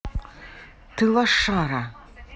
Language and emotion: Russian, angry